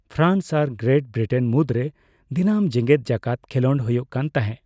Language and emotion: Santali, neutral